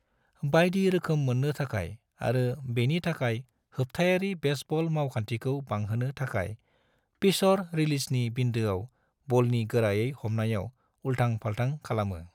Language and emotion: Bodo, neutral